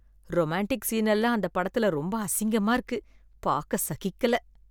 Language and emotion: Tamil, disgusted